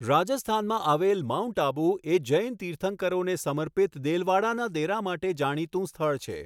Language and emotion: Gujarati, neutral